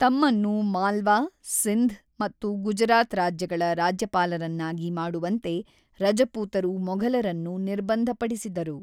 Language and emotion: Kannada, neutral